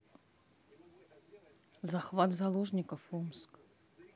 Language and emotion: Russian, neutral